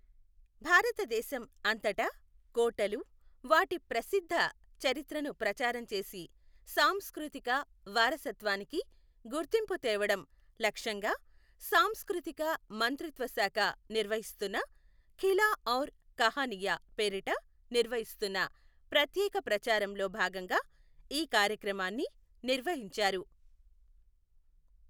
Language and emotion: Telugu, neutral